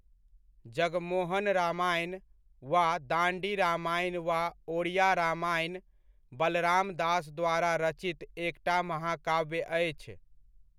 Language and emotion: Maithili, neutral